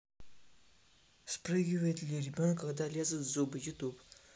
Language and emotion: Russian, neutral